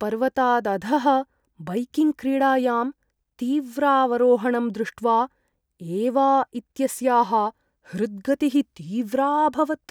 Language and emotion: Sanskrit, fearful